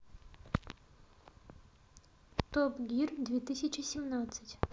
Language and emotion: Russian, neutral